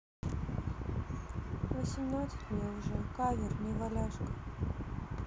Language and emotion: Russian, sad